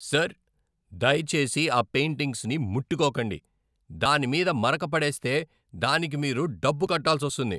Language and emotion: Telugu, angry